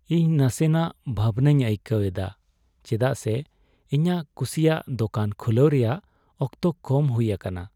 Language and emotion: Santali, sad